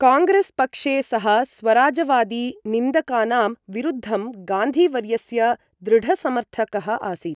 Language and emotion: Sanskrit, neutral